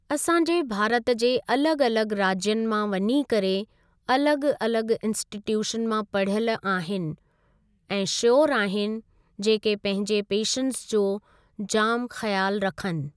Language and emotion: Sindhi, neutral